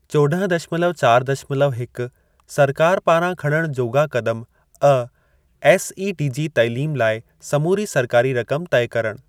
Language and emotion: Sindhi, neutral